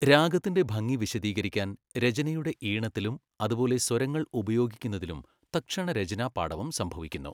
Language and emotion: Malayalam, neutral